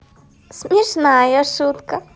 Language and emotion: Russian, positive